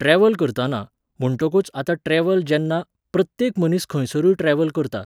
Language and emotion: Goan Konkani, neutral